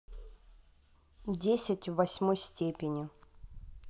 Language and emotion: Russian, neutral